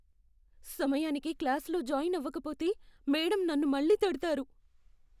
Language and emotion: Telugu, fearful